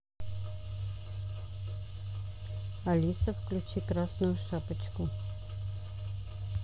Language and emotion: Russian, neutral